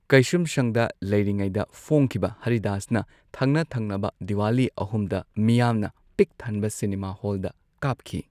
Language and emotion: Manipuri, neutral